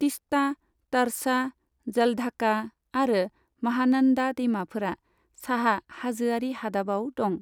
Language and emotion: Bodo, neutral